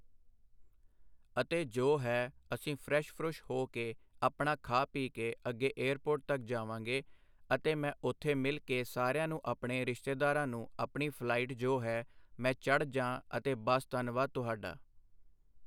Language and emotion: Punjabi, neutral